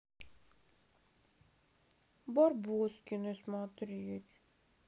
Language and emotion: Russian, sad